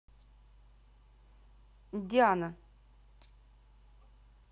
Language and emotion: Russian, neutral